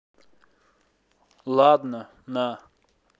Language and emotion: Russian, neutral